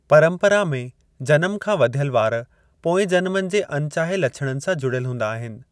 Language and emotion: Sindhi, neutral